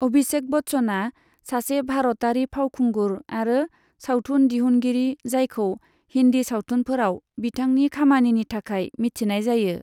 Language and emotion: Bodo, neutral